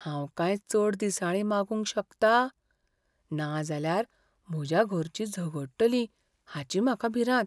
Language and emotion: Goan Konkani, fearful